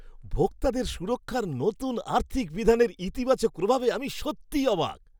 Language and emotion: Bengali, surprised